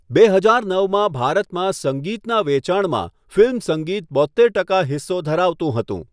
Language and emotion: Gujarati, neutral